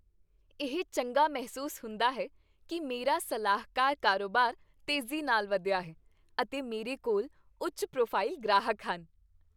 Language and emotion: Punjabi, happy